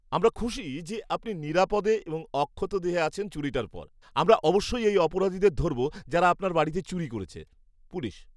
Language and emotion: Bengali, happy